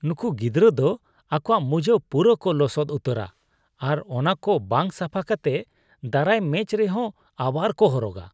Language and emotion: Santali, disgusted